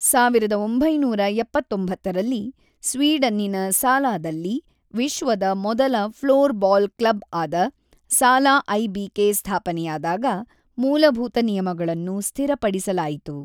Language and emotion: Kannada, neutral